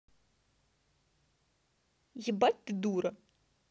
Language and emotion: Russian, angry